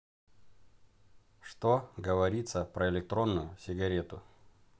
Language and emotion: Russian, neutral